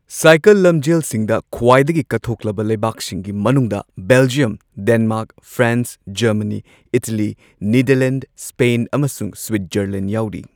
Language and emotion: Manipuri, neutral